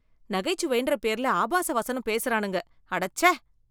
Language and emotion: Tamil, disgusted